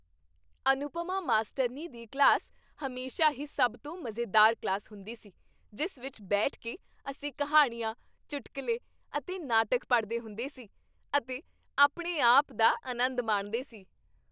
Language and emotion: Punjabi, happy